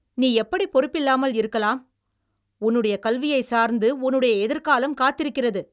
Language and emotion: Tamil, angry